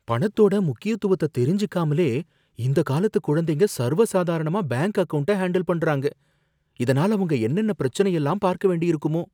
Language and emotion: Tamil, fearful